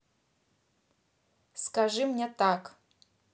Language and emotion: Russian, neutral